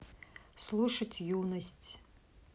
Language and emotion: Russian, neutral